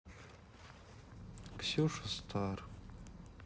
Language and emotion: Russian, sad